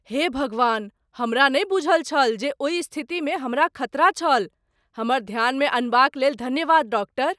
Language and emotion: Maithili, surprised